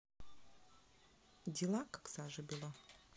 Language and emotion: Russian, neutral